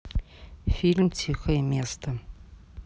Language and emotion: Russian, neutral